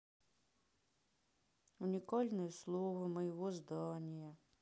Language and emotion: Russian, sad